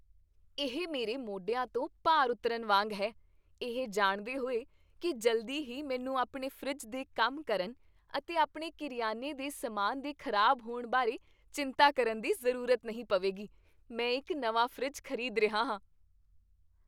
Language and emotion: Punjabi, happy